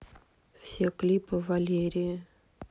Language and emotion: Russian, neutral